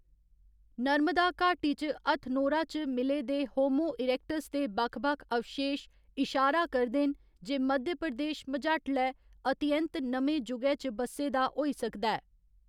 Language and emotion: Dogri, neutral